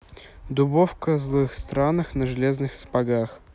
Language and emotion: Russian, neutral